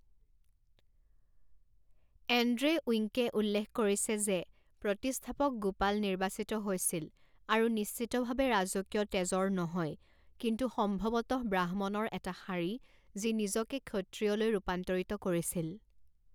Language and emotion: Assamese, neutral